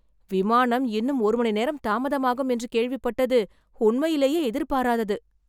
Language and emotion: Tamil, surprised